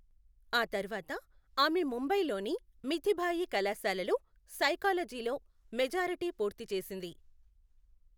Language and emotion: Telugu, neutral